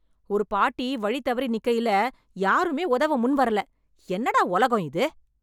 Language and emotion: Tamil, angry